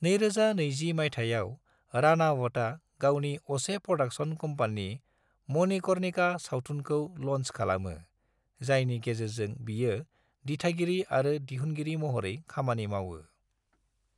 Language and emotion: Bodo, neutral